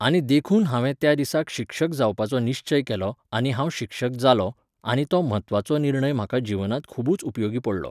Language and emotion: Goan Konkani, neutral